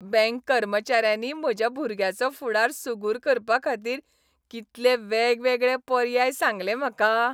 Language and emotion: Goan Konkani, happy